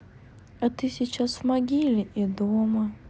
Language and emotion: Russian, sad